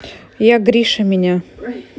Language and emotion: Russian, neutral